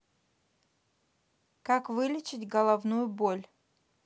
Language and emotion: Russian, neutral